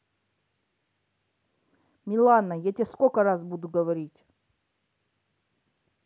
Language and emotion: Russian, angry